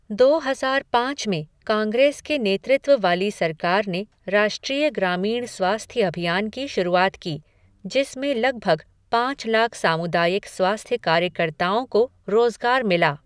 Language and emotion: Hindi, neutral